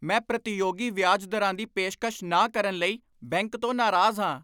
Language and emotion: Punjabi, angry